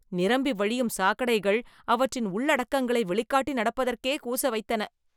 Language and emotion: Tamil, disgusted